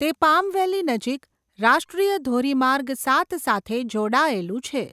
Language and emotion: Gujarati, neutral